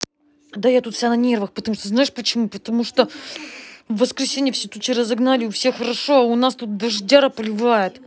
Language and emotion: Russian, angry